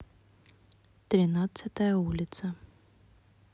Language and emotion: Russian, neutral